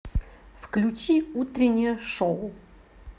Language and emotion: Russian, positive